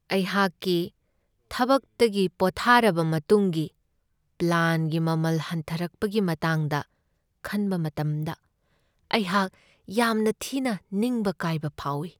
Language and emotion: Manipuri, sad